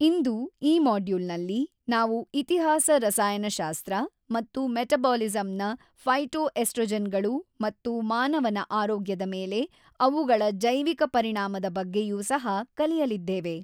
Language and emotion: Kannada, neutral